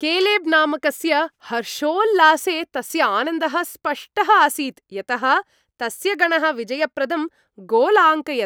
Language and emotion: Sanskrit, happy